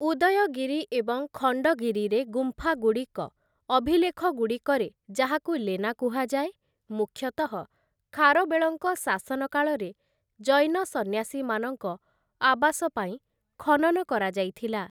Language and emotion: Odia, neutral